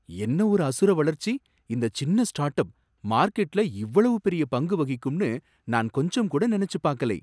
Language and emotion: Tamil, surprised